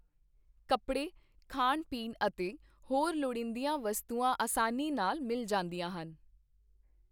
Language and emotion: Punjabi, neutral